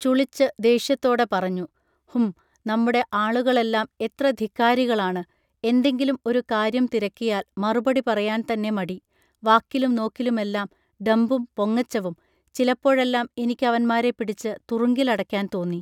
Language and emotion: Malayalam, neutral